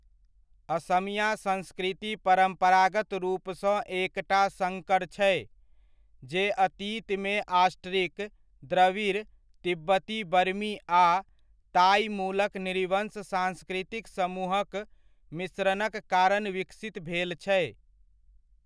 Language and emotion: Maithili, neutral